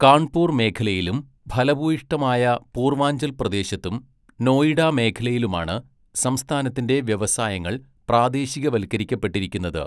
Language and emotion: Malayalam, neutral